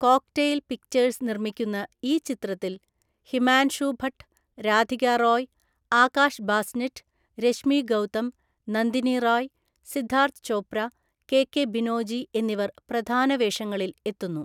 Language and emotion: Malayalam, neutral